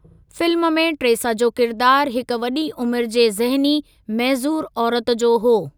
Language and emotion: Sindhi, neutral